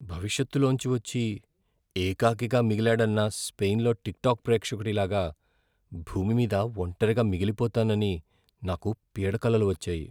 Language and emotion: Telugu, fearful